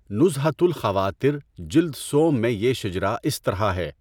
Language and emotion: Urdu, neutral